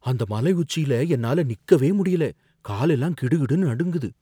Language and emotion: Tamil, fearful